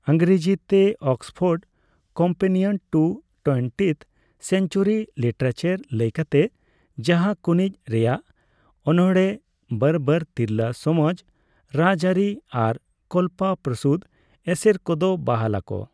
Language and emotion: Santali, neutral